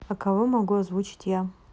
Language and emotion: Russian, neutral